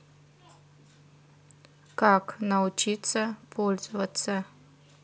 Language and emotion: Russian, neutral